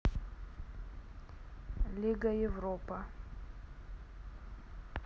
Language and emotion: Russian, neutral